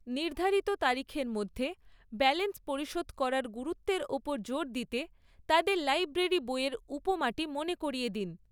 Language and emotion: Bengali, neutral